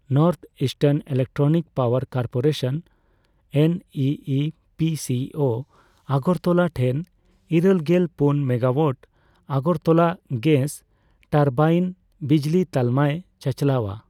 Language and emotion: Santali, neutral